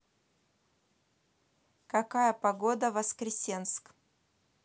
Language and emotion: Russian, neutral